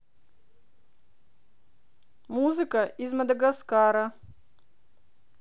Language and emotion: Russian, positive